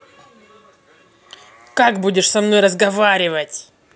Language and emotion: Russian, angry